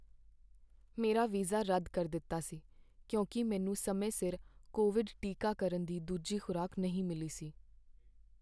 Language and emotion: Punjabi, sad